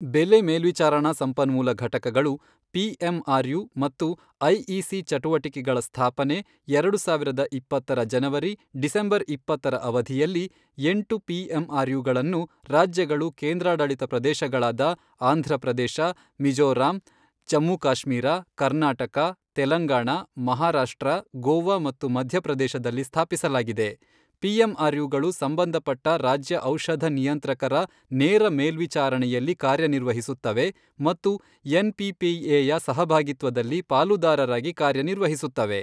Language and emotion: Kannada, neutral